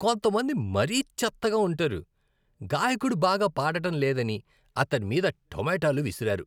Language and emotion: Telugu, disgusted